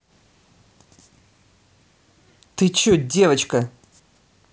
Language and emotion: Russian, angry